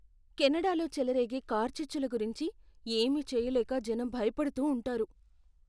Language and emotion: Telugu, fearful